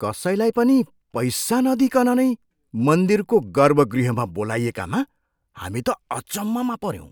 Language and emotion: Nepali, surprised